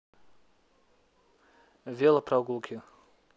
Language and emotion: Russian, neutral